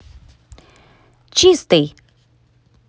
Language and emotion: Russian, positive